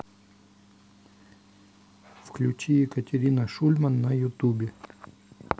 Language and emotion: Russian, neutral